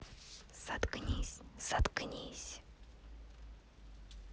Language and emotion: Russian, angry